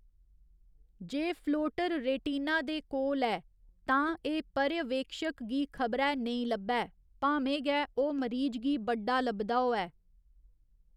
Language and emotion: Dogri, neutral